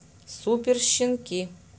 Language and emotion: Russian, neutral